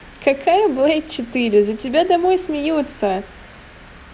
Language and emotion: Russian, positive